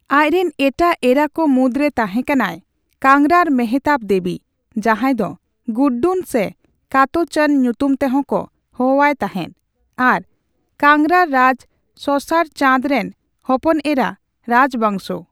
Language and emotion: Santali, neutral